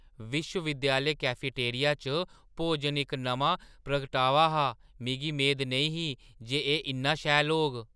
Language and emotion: Dogri, surprised